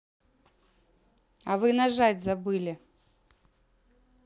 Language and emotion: Russian, neutral